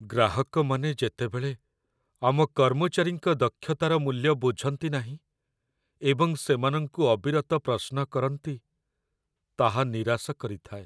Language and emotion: Odia, sad